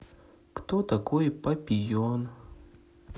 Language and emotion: Russian, sad